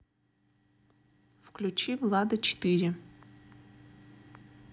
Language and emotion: Russian, neutral